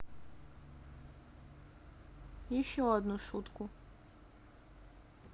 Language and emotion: Russian, sad